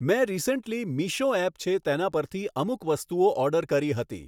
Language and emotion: Gujarati, neutral